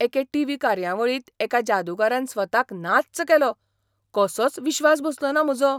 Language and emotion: Goan Konkani, surprised